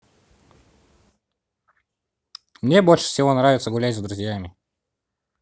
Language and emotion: Russian, positive